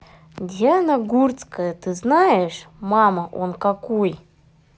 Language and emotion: Russian, neutral